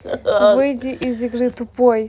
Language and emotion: Russian, neutral